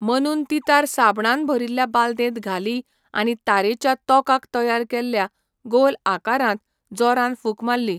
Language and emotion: Goan Konkani, neutral